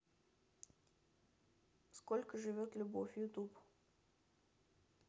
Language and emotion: Russian, neutral